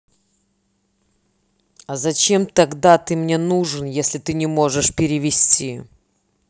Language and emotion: Russian, angry